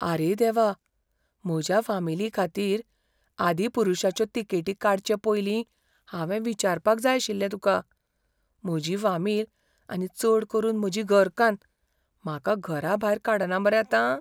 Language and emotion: Goan Konkani, fearful